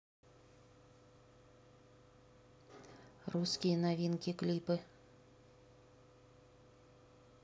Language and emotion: Russian, neutral